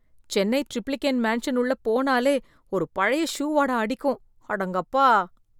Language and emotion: Tamil, disgusted